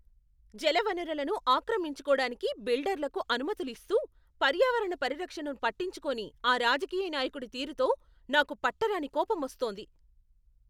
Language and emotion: Telugu, angry